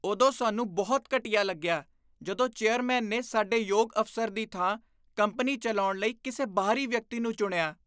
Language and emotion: Punjabi, disgusted